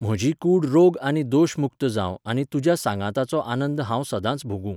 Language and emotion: Goan Konkani, neutral